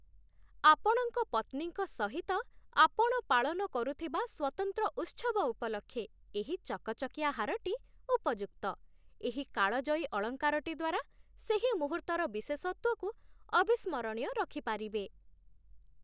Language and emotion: Odia, happy